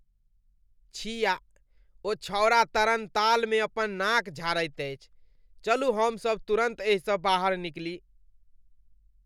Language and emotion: Maithili, disgusted